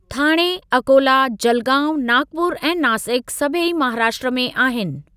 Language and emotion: Sindhi, neutral